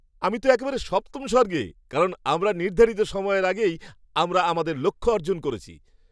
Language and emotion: Bengali, happy